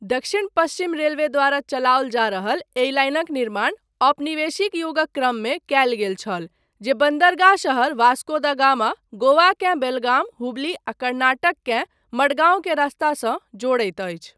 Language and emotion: Maithili, neutral